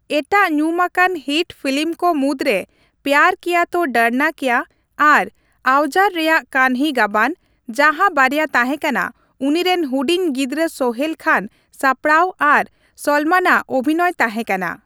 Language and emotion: Santali, neutral